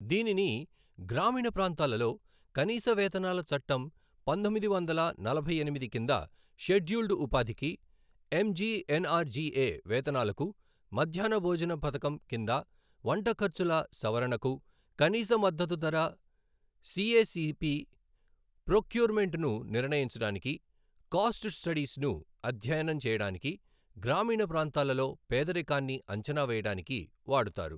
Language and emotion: Telugu, neutral